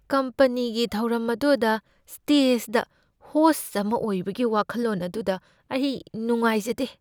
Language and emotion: Manipuri, fearful